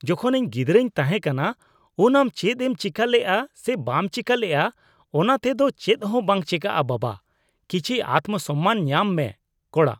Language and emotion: Santali, disgusted